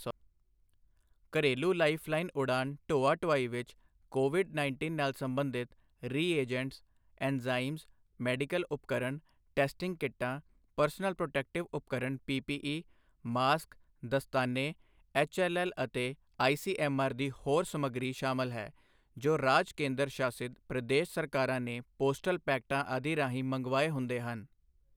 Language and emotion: Punjabi, neutral